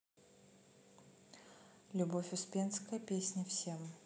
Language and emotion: Russian, neutral